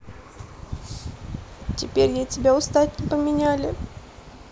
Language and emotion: Russian, sad